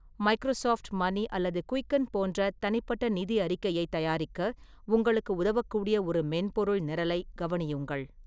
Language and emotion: Tamil, neutral